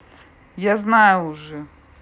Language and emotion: Russian, angry